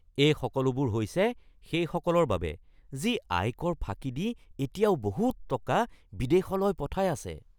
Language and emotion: Assamese, disgusted